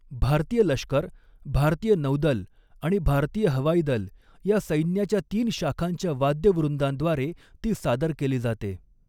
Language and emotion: Marathi, neutral